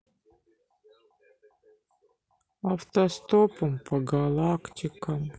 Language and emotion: Russian, sad